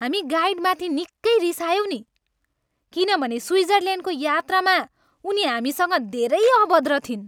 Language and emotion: Nepali, angry